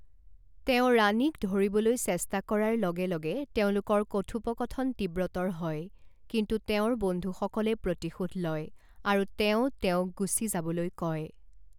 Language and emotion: Assamese, neutral